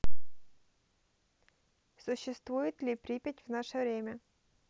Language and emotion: Russian, neutral